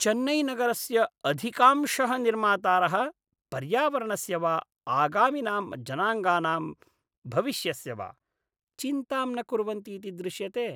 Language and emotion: Sanskrit, disgusted